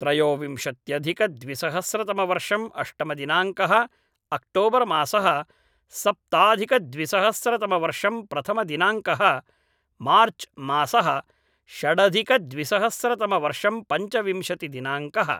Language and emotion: Sanskrit, neutral